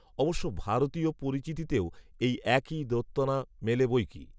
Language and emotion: Bengali, neutral